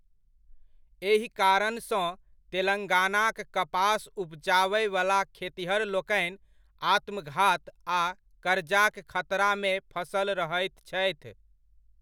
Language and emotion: Maithili, neutral